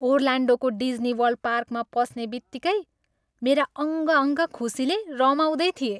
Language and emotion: Nepali, happy